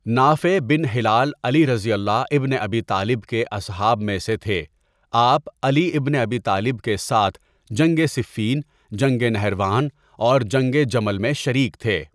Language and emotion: Urdu, neutral